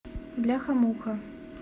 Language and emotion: Russian, neutral